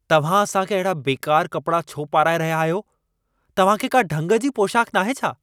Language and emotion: Sindhi, angry